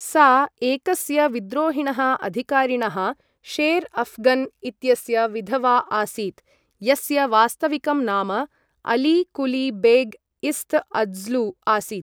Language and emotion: Sanskrit, neutral